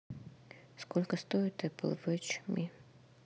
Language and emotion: Russian, neutral